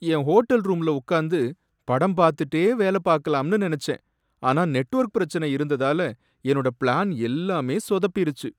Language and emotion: Tamil, sad